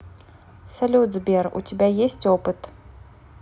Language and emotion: Russian, neutral